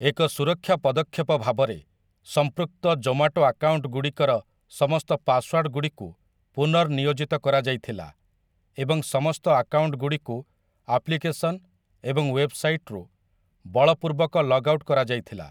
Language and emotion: Odia, neutral